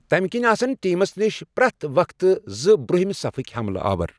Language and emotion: Kashmiri, neutral